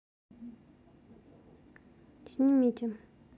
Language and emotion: Russian, neutral